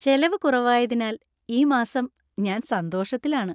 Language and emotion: Malayalam, happy